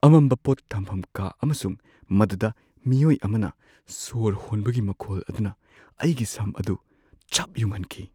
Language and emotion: Manipuri, fearful